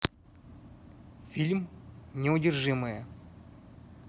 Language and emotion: Russian, neutral